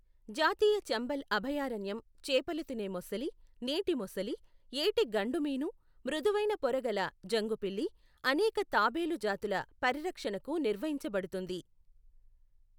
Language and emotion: Telugu, neutral